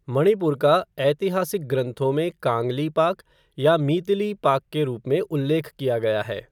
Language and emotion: Hindi, neutral